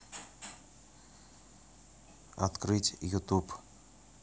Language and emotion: Russian, neutral